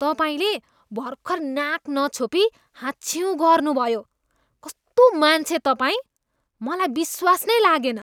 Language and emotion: Nepali, disgusted